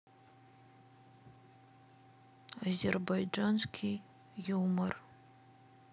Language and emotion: Russian, sad